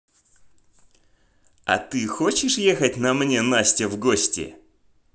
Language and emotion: Russian, positive